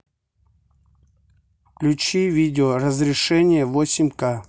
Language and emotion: Russian, neutral